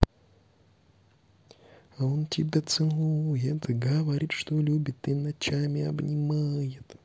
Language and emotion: Russian, positive